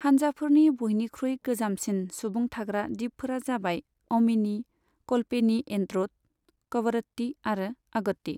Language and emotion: Bodo, neutral